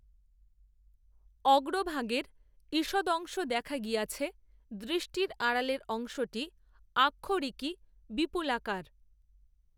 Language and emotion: Bengali, neutral